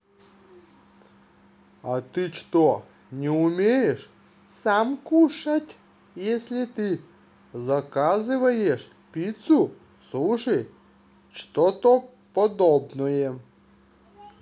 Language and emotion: Russian, neutral